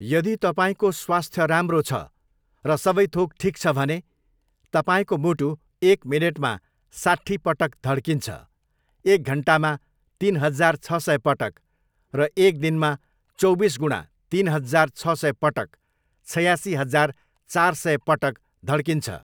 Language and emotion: Nepali, neutral